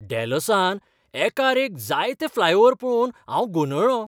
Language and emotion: Goan Konkani, surprised